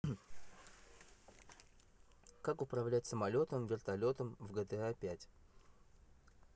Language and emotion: Russian, neutral